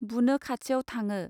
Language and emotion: Bodo, neutral